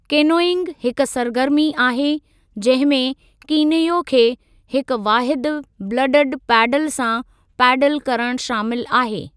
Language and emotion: Sindhi, neutral